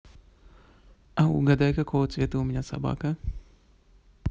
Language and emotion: Russian, positive